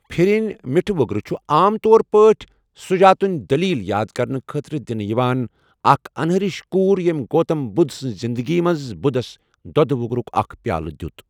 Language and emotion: Kashmiri, neutral